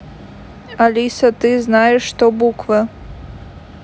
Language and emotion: Russian, neutral